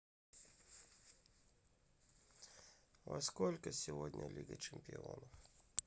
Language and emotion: Russian, sad